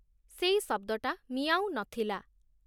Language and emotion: Odia, neutral